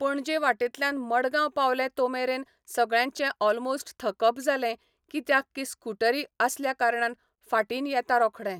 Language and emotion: Goan Konkani, neutral